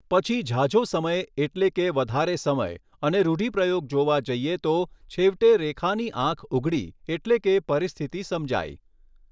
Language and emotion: Gujarati, neutral